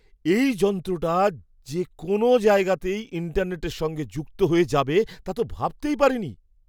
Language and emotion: Bengali, surprised